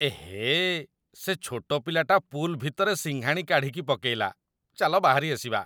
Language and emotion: Odia, disgusted